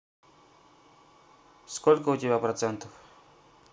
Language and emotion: Russian, neutral